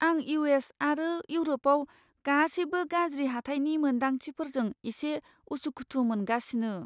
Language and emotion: Bodo, fearful